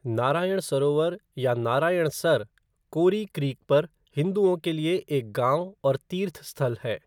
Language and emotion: Hindi, neutral